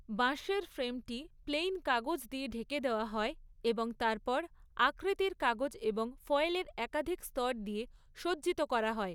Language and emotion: Bengali, neutral